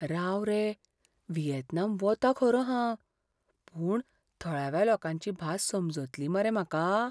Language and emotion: Goan Konkani, fearful